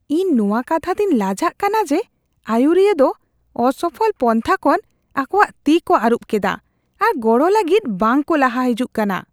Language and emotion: Santali, disgusted